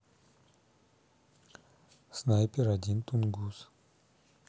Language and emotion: Russian, neutral